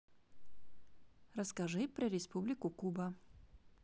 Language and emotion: Russian, neutral